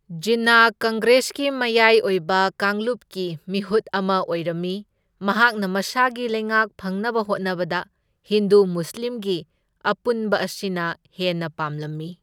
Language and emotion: Manipuri, neutral